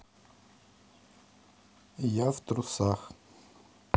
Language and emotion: Russian, neutral